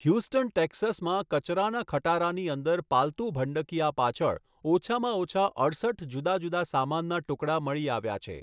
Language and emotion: Gujarati, neutral